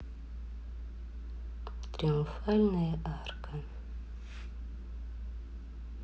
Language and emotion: Russian, neutral